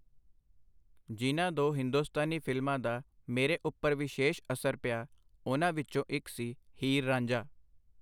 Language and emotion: Punjabi, neutral